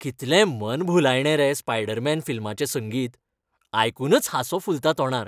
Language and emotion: Goan Konkani, happy